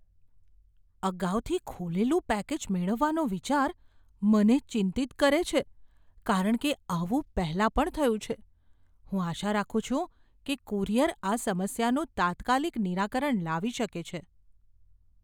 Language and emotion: Gujarati, fearful